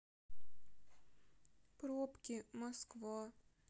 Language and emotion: Russian, sad